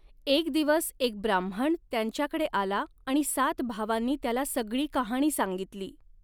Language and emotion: Marathi, neutral